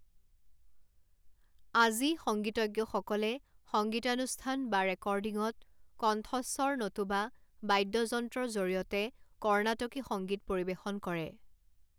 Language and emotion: Assamese, neutral